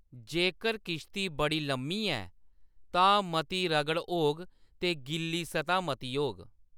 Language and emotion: Dogri, neutral